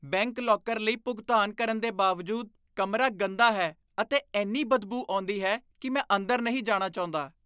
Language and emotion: Punjabi, disgusted